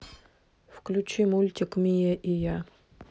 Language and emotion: Russian, neutral